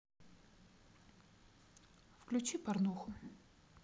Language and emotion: Russian, neutral